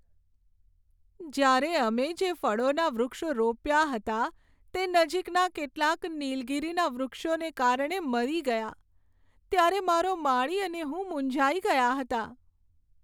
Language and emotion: Gujarati, sad